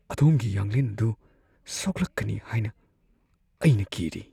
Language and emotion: Manipuri, fearful